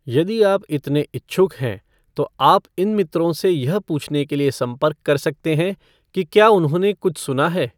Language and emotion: Hindi, neutral